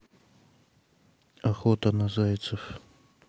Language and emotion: Russian, neutral